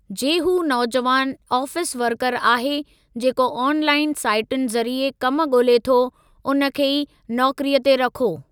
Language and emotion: Sindhi, neutral